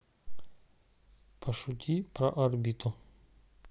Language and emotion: Russian, neutral